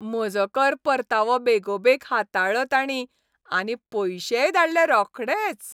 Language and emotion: Goan Konkani, happy